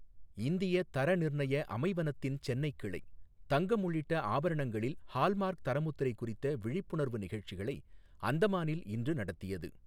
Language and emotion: Tamil, neutral